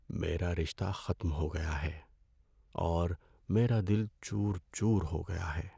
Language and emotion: Urdu, sad